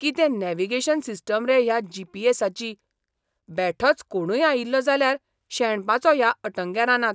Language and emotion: Goan Konkani, surprised